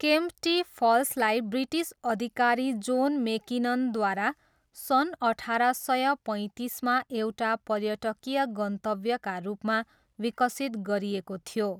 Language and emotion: Nepali, neutral